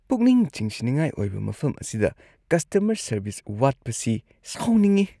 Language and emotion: Manipuri, disgusted